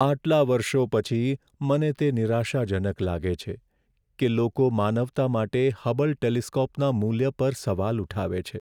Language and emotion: Gujarati, sad